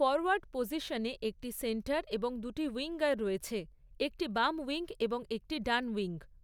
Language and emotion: Bengali, neutral